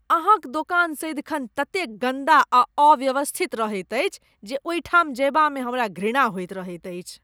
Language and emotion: Maithili, disgusted